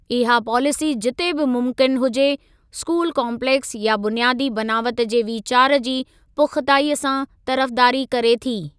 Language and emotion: Sindhi, neutral